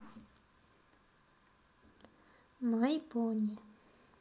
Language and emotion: Russian, neutral